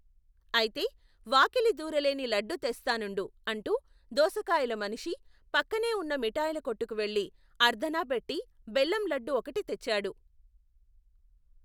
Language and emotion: Telugu, neutral